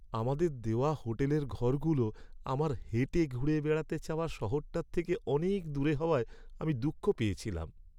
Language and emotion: Bengali, sad